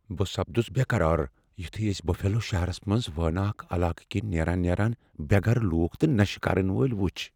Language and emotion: Kashmiri, fearful